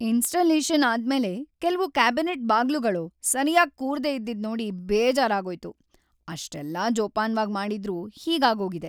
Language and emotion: Kannada, sad